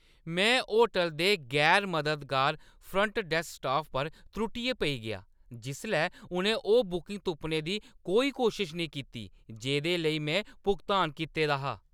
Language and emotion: Dogri, angry